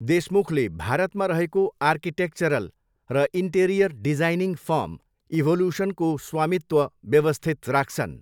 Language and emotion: Nepali, neutral